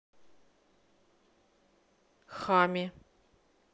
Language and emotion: Russian, neutral